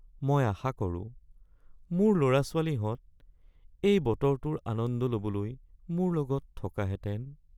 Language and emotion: Assamese, sad